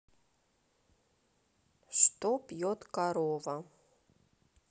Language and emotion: Russian, neutral